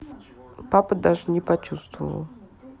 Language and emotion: Russian, neutral